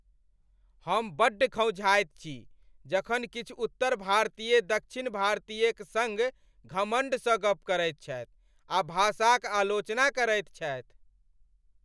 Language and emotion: Maithili, angry